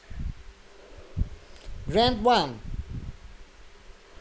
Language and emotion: Russian, neutral